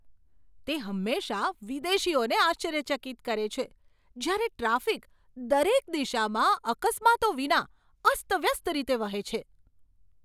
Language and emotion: Gujarati, surprised